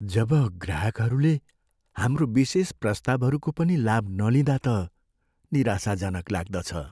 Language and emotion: Nepali, sad